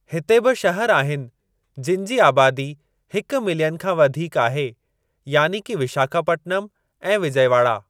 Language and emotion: Sindhi, neutral